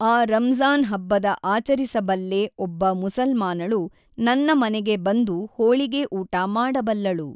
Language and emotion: Kannada, neutral